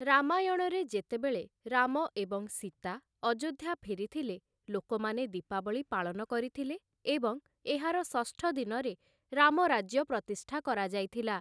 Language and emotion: Odia, neutral